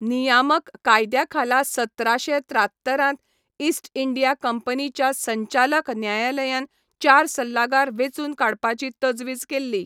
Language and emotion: Goan Konkani, neutral